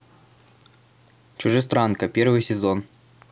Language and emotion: Russian, neutral